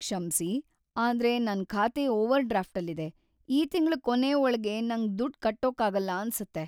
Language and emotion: Kannada, sad